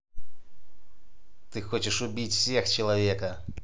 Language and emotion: Russian, angry